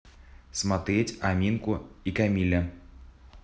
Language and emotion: Russian, neutral